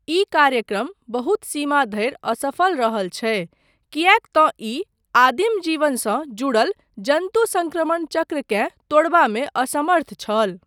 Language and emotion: Maithili, neutral